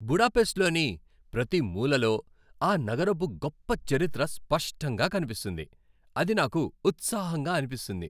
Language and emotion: Telugu, happy